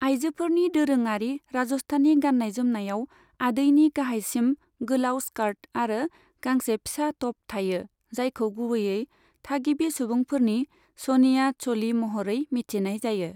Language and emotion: Bodo, neutral